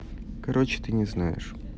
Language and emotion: Russian, neutral